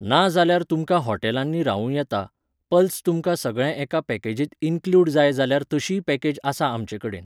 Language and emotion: Goan Konkani, neutral